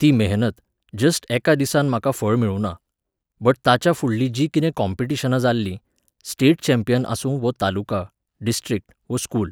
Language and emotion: Goan Konkani, neutral